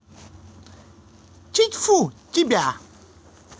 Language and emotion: Russian, positive